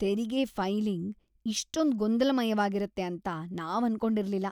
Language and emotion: Kannada, disgusted